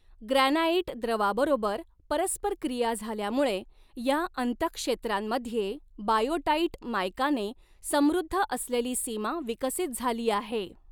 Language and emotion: Marathi, neutral